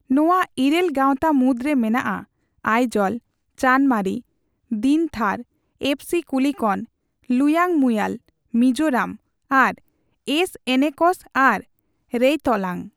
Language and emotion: Santali, neutral